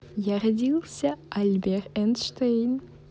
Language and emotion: Russian, positive